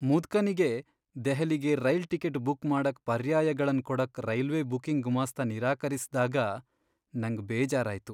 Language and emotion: Kannada, sad